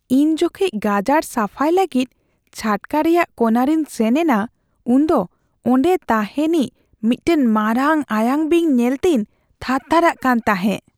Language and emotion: Santali, fearful